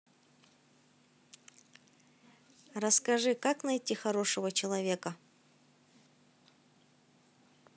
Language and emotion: Russian, positive